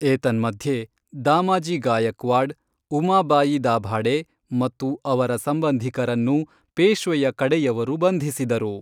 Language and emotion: Kannada, neutral